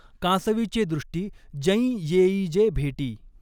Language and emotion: Marathi, neutral